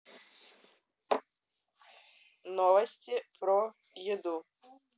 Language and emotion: Russian, neutral